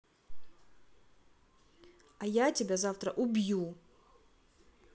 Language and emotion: Russian, angry